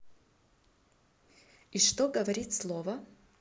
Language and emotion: Russian, neutral